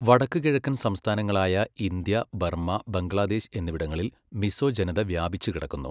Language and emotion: Malayalam, neutral